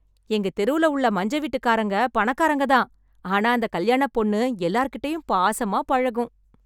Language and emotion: Tamil, happy